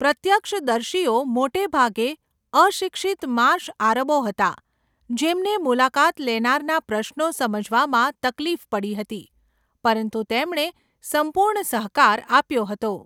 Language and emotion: Gujarati, neutral